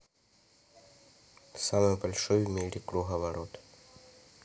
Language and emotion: Russian, neutral